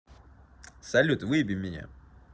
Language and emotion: Russian, neutral